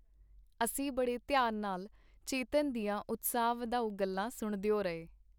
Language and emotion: Punjabi, neutral